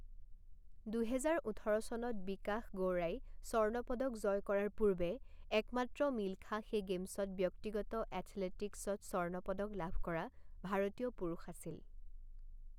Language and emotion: Assamese, neutral